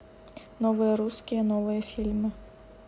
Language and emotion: Russian, neutral